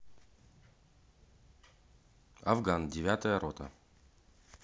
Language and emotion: Russian, neutral